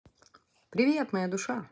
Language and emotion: Russian, positive